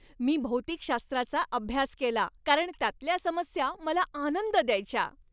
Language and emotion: Marathi, happy